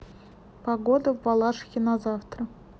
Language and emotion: Russian, neutral